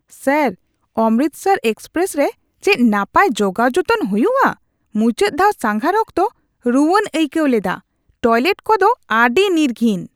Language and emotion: Santali, disgusted